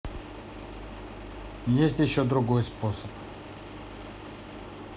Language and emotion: Russian, neutral